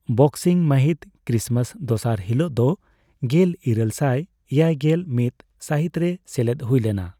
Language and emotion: Santali, neutral